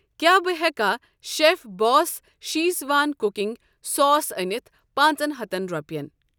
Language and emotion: Kashmiri, neutral